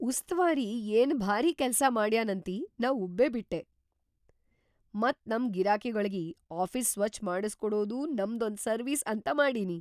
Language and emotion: Kannada, surprised